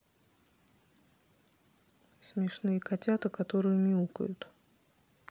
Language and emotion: Russian, neutral